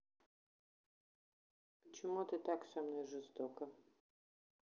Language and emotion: Russian, neutral